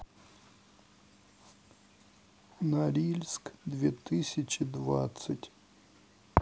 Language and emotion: Russian, sad